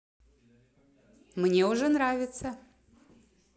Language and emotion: Russian, positive